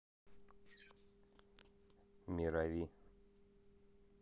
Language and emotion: Russian, neutral